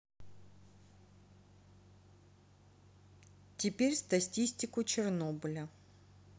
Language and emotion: Russian, neutral